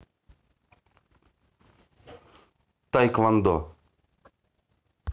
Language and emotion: Russian, neutral